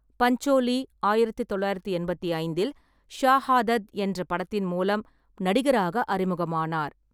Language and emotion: Tamil, neutral